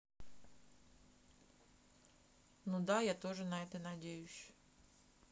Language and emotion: Russian, neutral